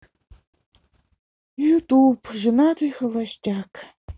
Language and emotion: Russian, sad